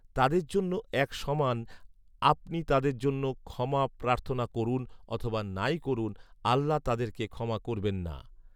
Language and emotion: Bengali, neutral